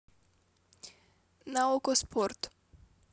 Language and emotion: Russian, neutral